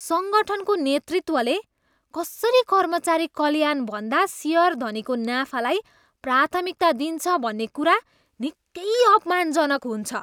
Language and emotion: Nepali, disgusted